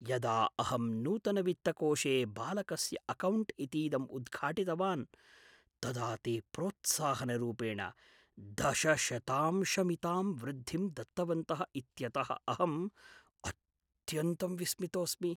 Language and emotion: Sanskrit, surprised